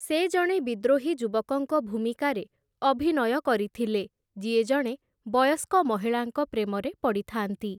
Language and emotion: Odia, neutral